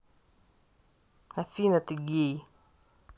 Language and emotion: Russian, angry